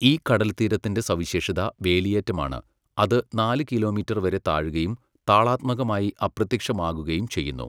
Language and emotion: Malayalam, neutral